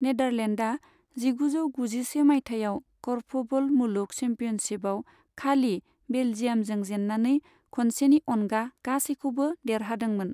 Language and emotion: Bodo, neutral